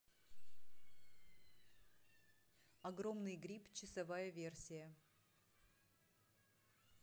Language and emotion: Russian, neutral